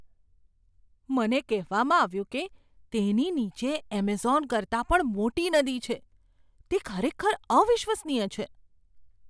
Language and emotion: Gujarati, surprised